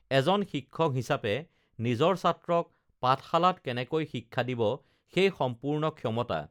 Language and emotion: Assamese, neutral